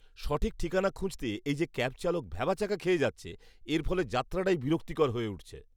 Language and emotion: Bengali, disgusted